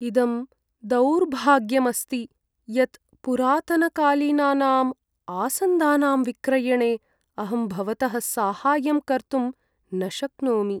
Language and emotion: Sanskrit, sad